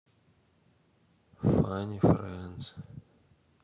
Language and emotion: Russian, neutral